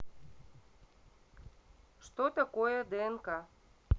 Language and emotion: Russian, neutral